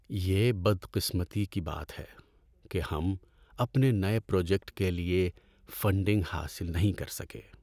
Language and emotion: Urdu, sad